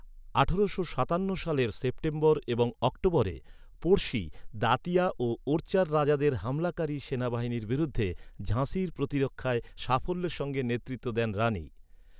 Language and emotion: Bengali, neutral